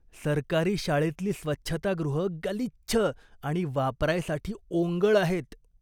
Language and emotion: Marathi, disgusted